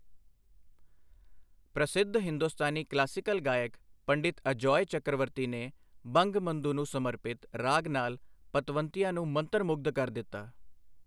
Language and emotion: Punjabi, neutral